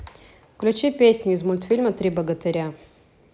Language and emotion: Russian, neutral